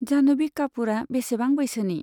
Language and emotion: Bodo, neutral